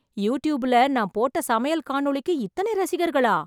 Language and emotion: Tamil, surprised